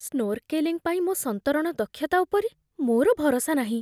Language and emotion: Odia, fearful